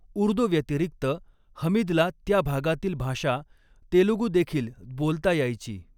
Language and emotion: Marathi, neutral